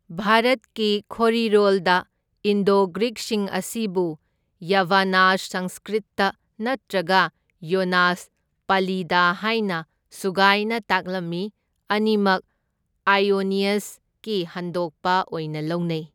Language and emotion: Manipuri, neutral